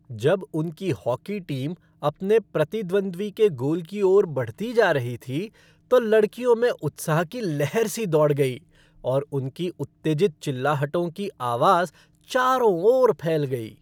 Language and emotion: Hindi, happy